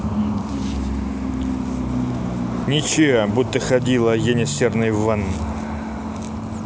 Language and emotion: Russian, neutral